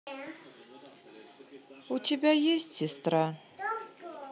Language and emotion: Russian, sad